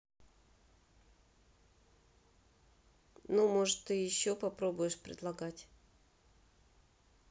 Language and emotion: Russian, neutral